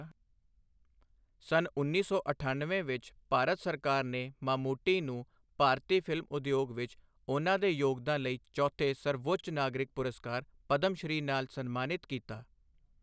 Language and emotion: Punjabi, neutral